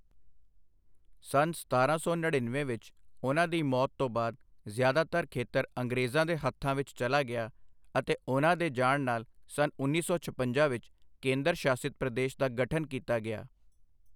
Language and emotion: Punjabi, neutral